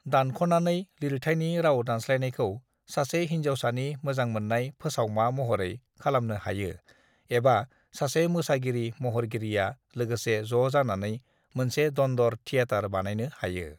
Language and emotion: Bodo, neutral